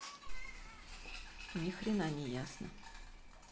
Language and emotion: Russian, neutral